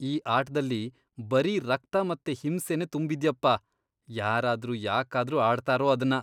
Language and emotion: Kannada, disgusted